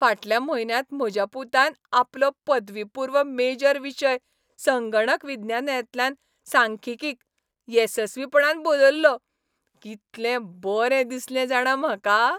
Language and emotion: Goan Konkani, happy